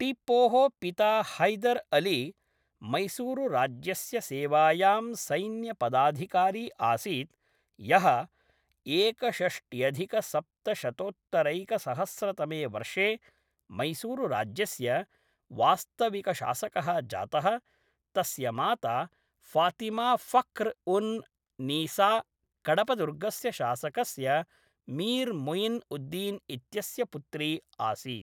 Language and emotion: Sanskrit, neutral